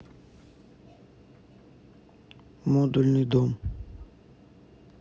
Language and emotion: Russian, neutral